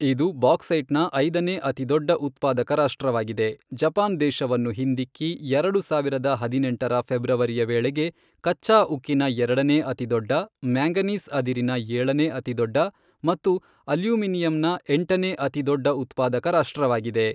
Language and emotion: Kannada, neutral